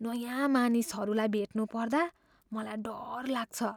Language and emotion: Nepali, fearful